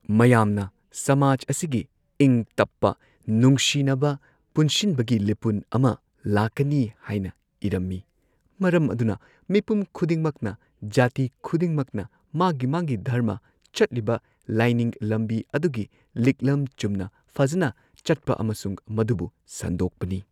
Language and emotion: Manipuri, neutral